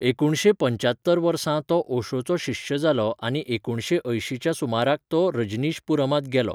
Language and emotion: Goan Konkani, neutral